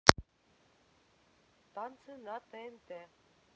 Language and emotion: Russian, neutral